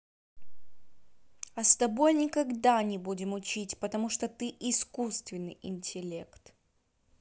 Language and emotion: Russian, angry